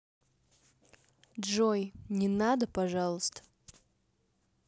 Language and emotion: Russian, neutral